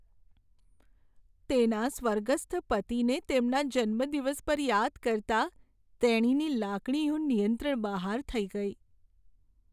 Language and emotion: Gujarati, sad